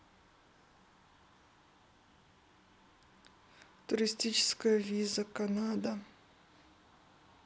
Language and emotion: Russian, neutral